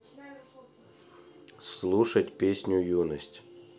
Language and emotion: Russian, neutral